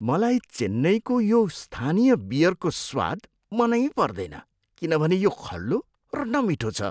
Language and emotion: Nepali, disgusted